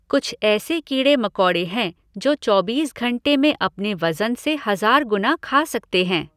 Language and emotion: Hindi, neutral